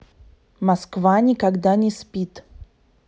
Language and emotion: Russian, neutral